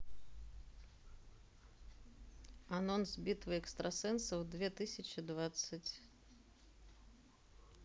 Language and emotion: Russian, neutral